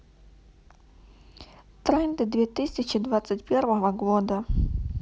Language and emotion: Russian, neutral